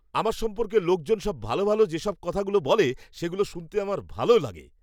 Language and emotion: Bengali, happy